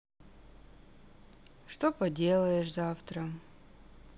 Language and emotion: Russian, sad